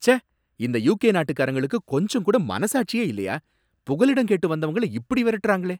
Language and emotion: Tamil, angry